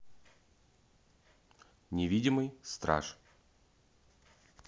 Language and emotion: Russian, neutral